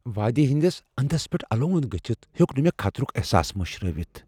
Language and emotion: Kashmiri, fearful